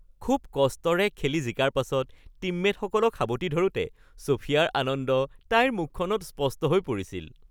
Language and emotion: Assamese, happy